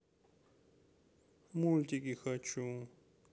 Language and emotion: Russian, sad